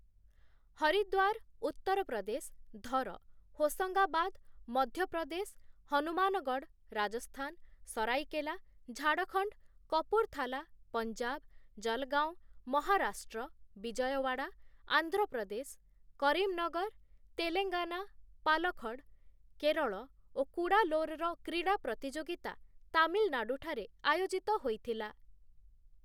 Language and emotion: Odia, neutral